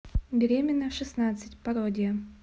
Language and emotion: Russian, neutral